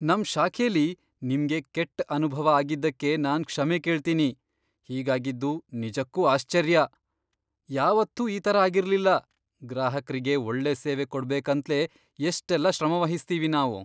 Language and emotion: Kannada, surprised